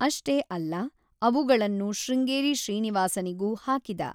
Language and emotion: Kannada, neutral